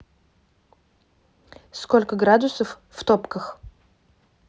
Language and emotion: Russian, neutral